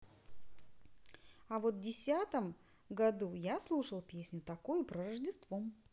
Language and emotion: Russian, positive